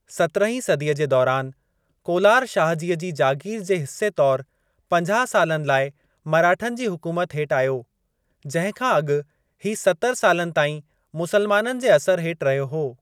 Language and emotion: Sindhi, neutral